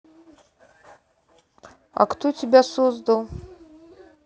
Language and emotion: Russian, neutral